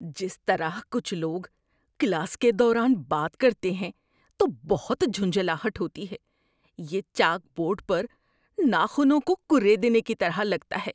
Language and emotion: Urdu, disgusted